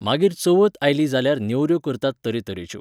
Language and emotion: Goan Konkani, neutral